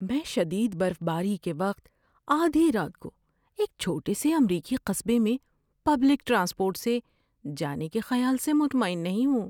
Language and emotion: Urdu, fearful